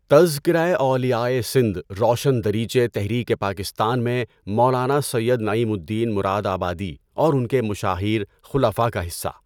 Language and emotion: Urdu, neutral